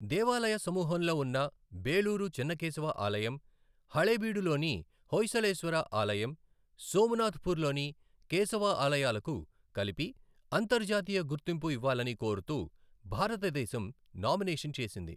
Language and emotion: Telugu, neutral